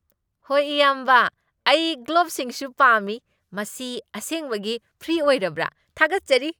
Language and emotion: Manipuri, happy